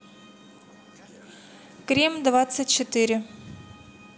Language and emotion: Russian, neutral